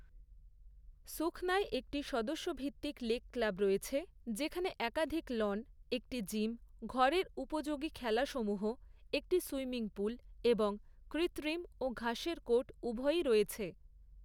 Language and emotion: Bengali, neutral